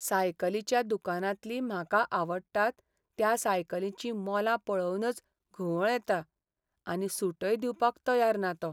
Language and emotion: Goan Konkani, sad